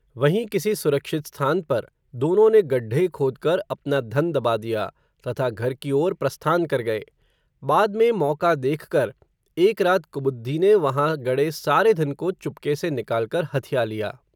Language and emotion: Hindi, neutral